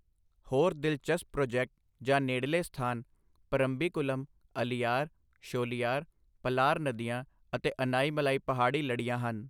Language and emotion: Punjabi, neutral